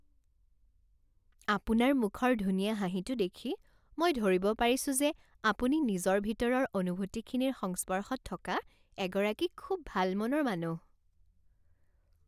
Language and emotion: Assamese, happy